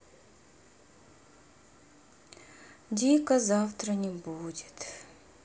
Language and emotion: Russian, sad